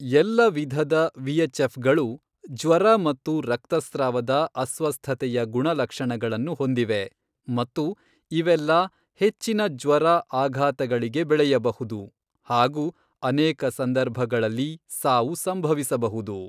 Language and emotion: Kannada, neutral